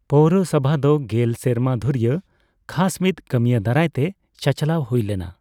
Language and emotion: Santali, neutral